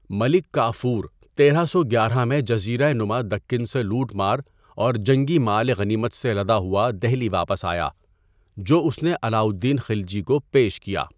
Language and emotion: Urdu, neutral